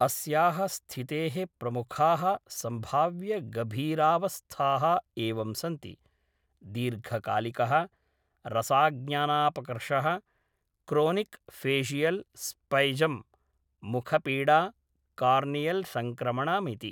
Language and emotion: Sanskrit, neutral